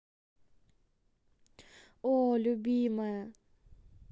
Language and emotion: Russian, neutral